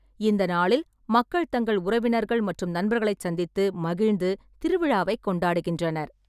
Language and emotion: Tamil, neutral